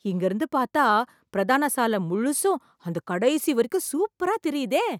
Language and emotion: Tamil, surprised